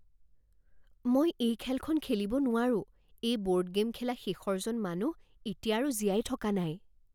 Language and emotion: Assamese, fearful